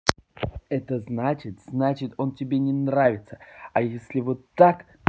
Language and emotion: Russian, angry